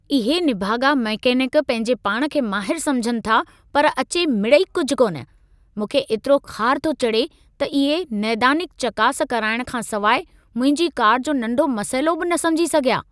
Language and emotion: Sindhi, angry